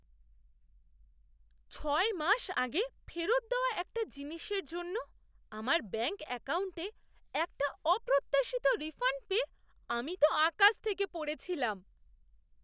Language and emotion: Bengali, surprised